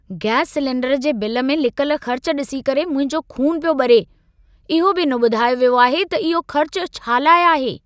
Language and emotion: Sindhi, angry